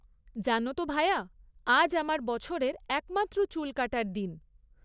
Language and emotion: Bengali, neutral